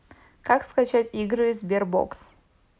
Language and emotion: Russian, neutral